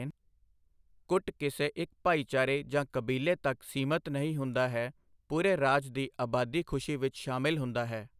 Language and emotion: Punjabi, neutral